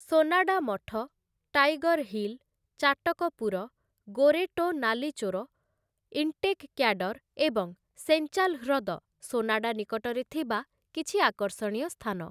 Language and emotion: Odia, neutral